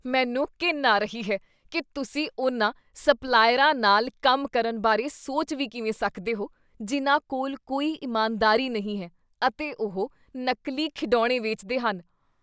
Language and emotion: Punjabi, disgusted